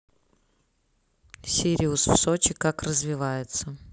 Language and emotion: Russian, neutral